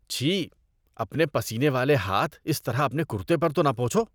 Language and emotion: Urdu, disgusted